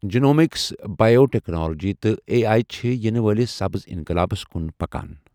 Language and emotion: Kashmiri, neutral